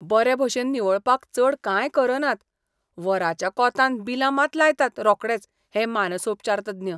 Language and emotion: Goan Konkani, disgusted